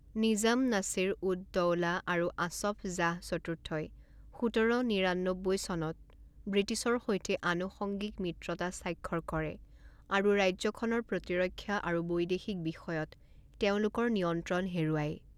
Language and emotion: Assamese, neutral